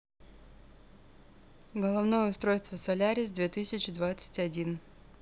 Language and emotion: Russian, neutral